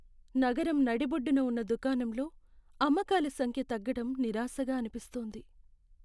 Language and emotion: Telugu, sad